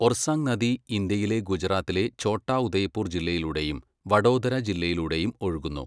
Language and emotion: Malayalam, neutral